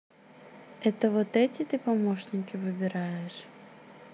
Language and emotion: Russian, neutral